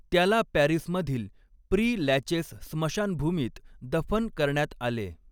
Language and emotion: Marathi, neutral